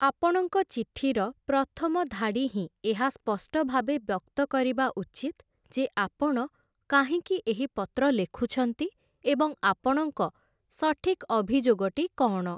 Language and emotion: Odia, neutral